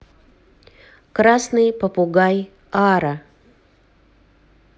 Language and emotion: Russian, neutral